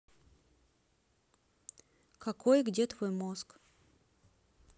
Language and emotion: Russian, neutral